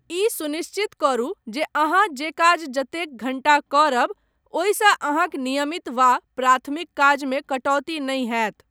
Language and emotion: Maithili, neutral